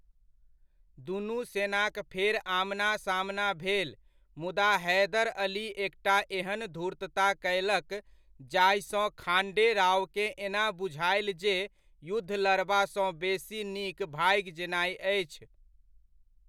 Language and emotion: Maithili, neutral